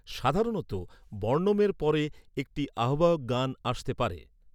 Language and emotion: Bengali, neutral